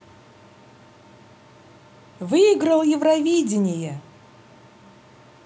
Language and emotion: Russian, positive